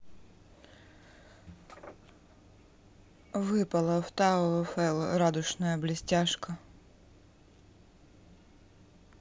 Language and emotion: Russian, neutral